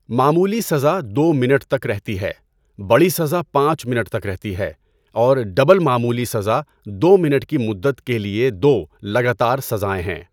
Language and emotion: Urdu, neutral